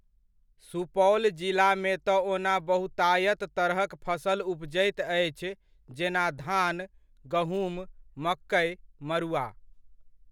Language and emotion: Maithili, neutral